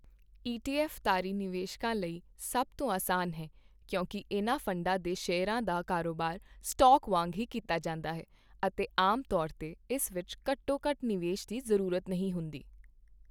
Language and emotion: Punjabi, neutral